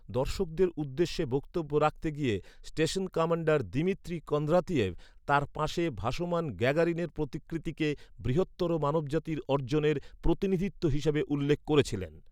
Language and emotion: Bengali, neutral